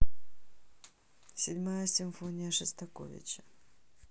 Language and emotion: Russian, neutral